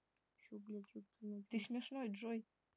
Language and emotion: Russian, neutral